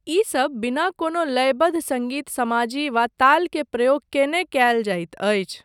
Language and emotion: Maithili, neutral